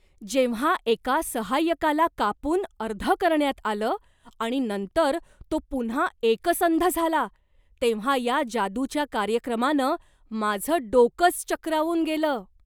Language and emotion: Marathi, surprised